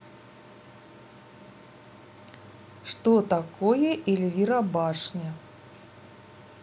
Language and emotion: Russian, neutral